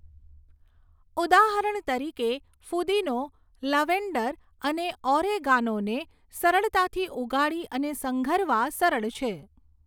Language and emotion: Gujarati, neutral